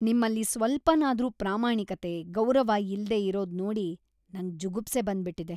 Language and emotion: Kannada, disgusted